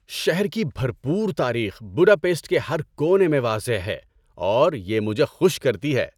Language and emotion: Urdu, happy